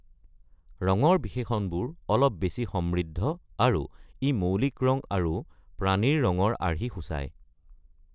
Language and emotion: Assamese, neutral